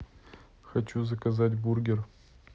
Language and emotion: Russian, neutral